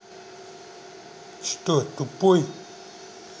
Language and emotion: Russian, angry